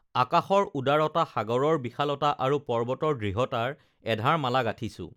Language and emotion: Assamese, neutral